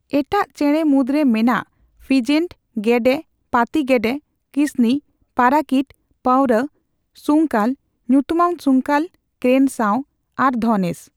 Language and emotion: Santali, neutral